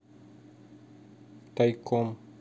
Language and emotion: Russian, neutral